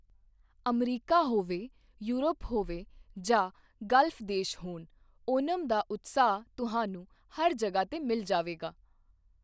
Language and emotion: Punjabi, neutral